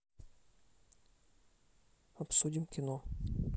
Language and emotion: Russian, neutral